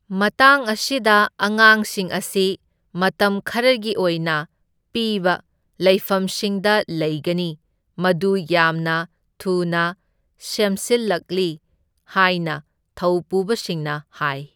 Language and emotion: Manipuri, neutral